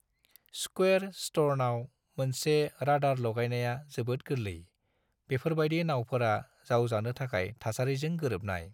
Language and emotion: Bodo, neutral